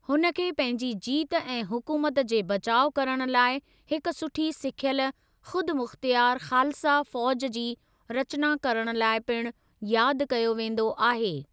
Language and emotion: Sindhi, neutral